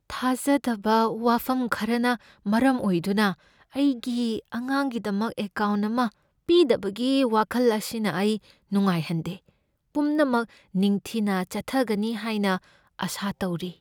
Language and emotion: Manipuri, fearful